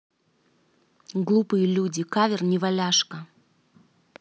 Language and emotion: Russian, angry